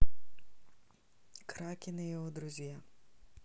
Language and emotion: Russian, neutral